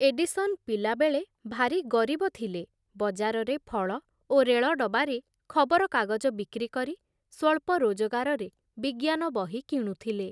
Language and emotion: Odia, neutral